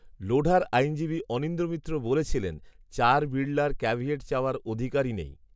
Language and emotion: Bengali, neutral